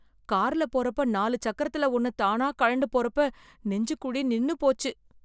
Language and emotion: Tamil, fearful